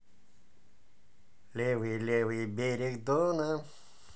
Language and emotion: Russian, positive